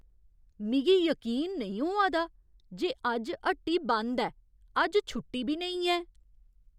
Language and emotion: Dogri, surprised